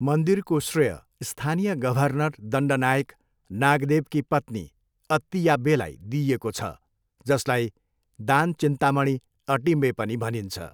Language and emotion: Nepali, neutral